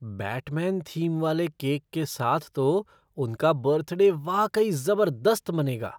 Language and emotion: Hindi, surprised